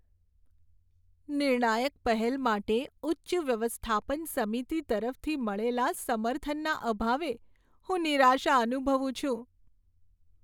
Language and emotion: Gujarati, sad